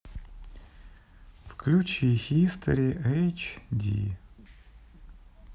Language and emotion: Russian, sad